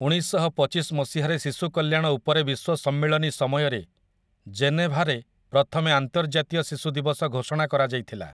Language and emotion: Odia, neutral